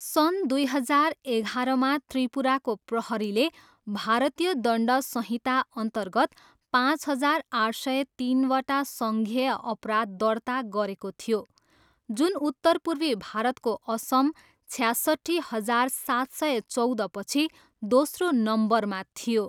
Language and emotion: Nepali, neutral